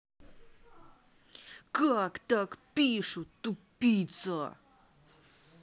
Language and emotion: Russian, angry